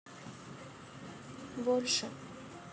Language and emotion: Russian, sad